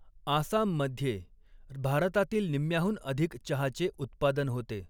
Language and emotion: Marathi, neutral